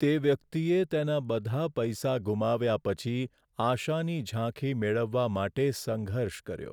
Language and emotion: Gujarati, sad